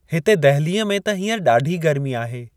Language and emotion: Sindhi, neutral